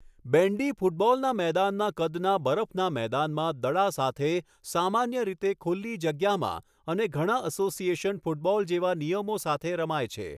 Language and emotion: Gujarati, neutral